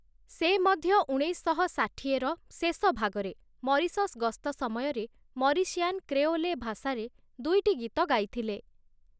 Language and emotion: Odia, neutral